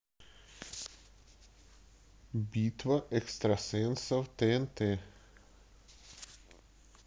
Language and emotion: Russian, neutral